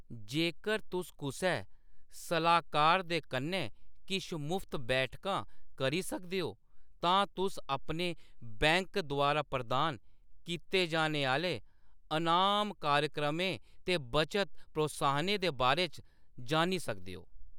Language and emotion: Dogri, neutral